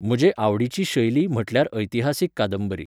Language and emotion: Goan Konkani, neutral